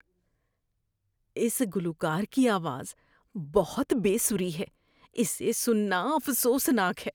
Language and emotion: Urdu, disgusted